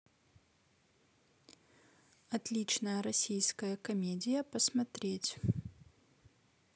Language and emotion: Russian, neutral